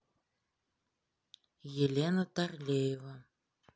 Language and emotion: Russian, neutral